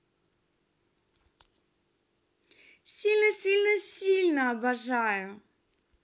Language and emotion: Russian, positive